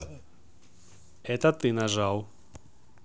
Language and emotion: Russian, neutral